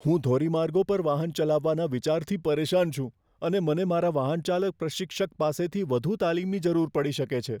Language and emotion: Gujarati, fearful